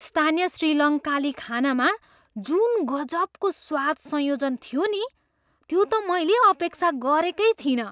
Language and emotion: Nepali, surprised